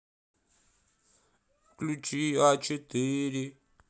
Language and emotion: Russian, sad